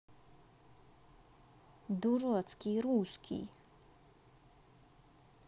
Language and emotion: Russian, angry